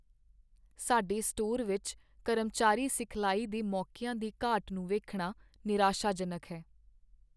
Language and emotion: Punjabi, sad